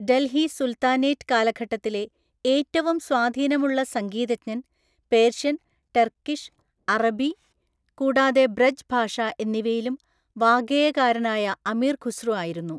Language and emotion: Malayalam, neutral